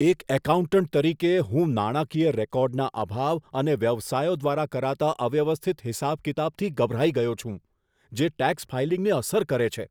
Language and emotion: Gujarati, disgusted